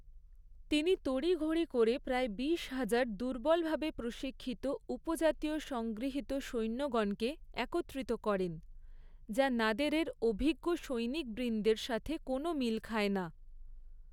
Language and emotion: Bengali, neutral